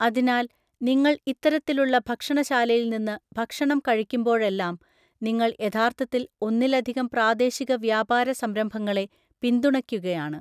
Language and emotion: Malayalam, neutral